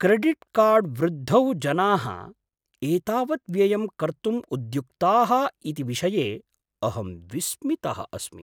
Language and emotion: Sanskrit, surprised